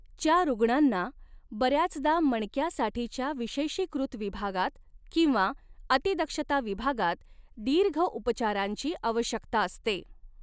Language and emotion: Marathi, neutral